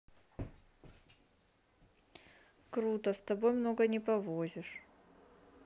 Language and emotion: Russian, neutral